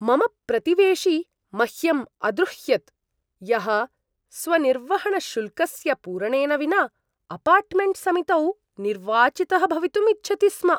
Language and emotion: Sanskrit, disgusted